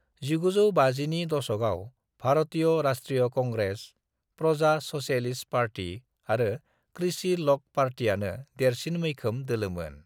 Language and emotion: Bodo, neutral